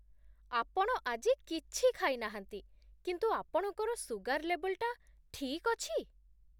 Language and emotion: Odia, surprised